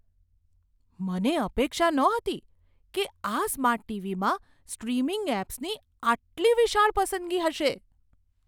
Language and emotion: Gujarati, surprised